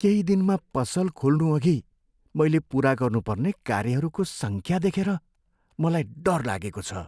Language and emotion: Nepali, fearful